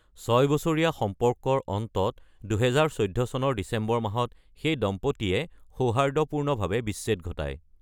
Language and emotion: Assamese, neutral